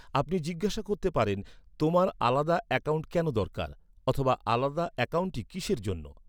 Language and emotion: Bengali, neutral